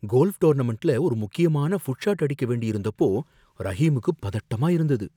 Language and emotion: Tamil, fearful